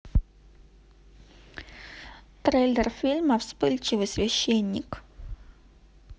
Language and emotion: Russian, neutral